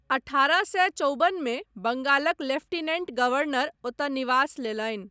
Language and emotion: Maithili, neutral